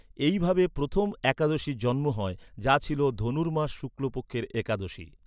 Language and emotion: Bengali, neutral